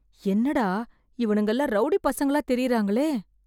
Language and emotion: Tamil, fearful